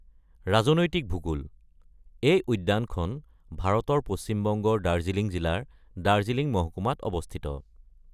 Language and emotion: Assamese, neutral